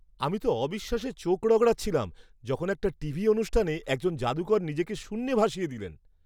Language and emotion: Bengali, surprised